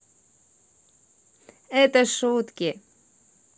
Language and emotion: Russian, positive